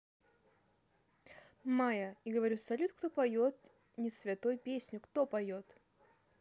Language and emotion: Russian, neutral